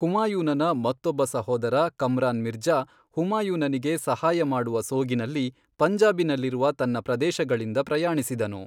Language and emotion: Kannada, neutral